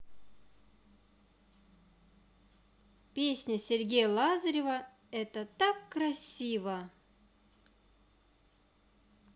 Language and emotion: Russian, positive